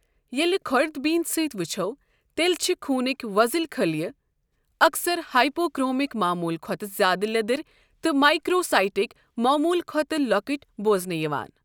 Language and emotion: Kashmiri, neutral